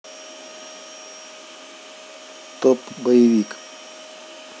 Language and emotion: Russian, neutral